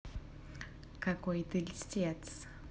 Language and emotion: Russian, neutral